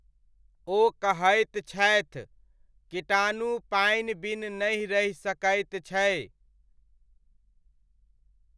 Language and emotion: Maithili, neutral